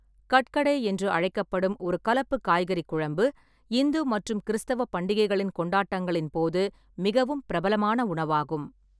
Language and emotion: Tamil, neutral